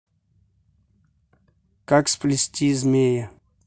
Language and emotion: Russian, neutral